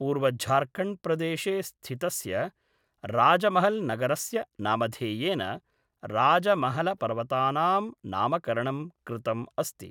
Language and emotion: Sanskrit, neutral